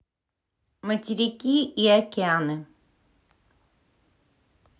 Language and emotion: Russian, neutral